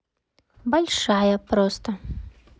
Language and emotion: Russian, neutral